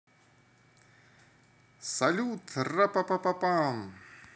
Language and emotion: Russian, positive